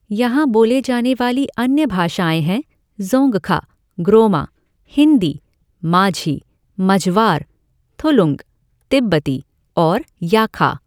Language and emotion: Hindi, neutral